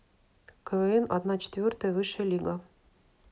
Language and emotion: Russian, neutral